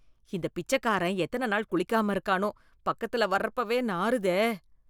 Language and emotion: Tamil, disgusted